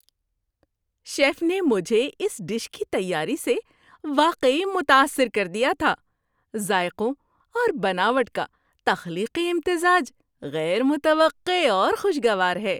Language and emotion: Urdu, surprised